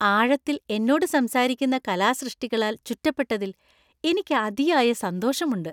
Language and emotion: Malayalam, happy